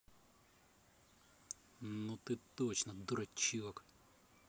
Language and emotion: Russian, angry